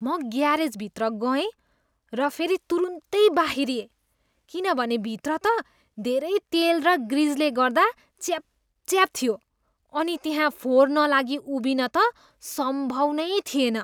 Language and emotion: Nepali, disgusted